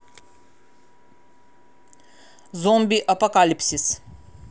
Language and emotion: Russian, neutral